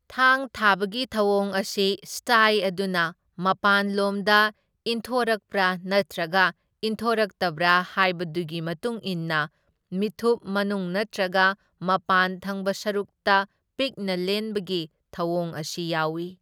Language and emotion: Manipuri, neutral